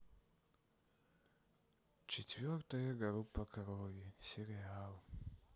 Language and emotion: Russian, sad